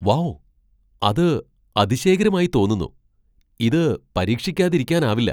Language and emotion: Malayalam, surprised